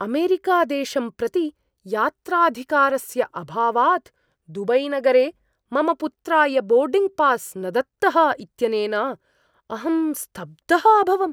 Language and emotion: Sanskrit, surprised